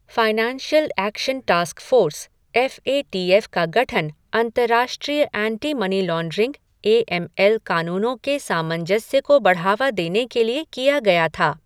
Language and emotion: Hindi, neutral